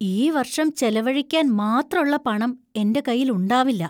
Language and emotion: Malayalam, fearful